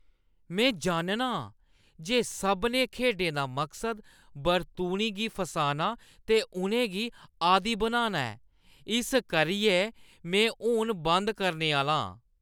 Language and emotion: Dogri, disgusted